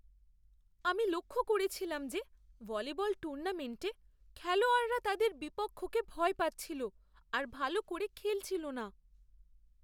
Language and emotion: Bengali, fearful